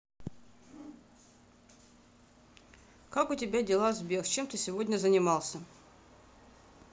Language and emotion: Russian, neutral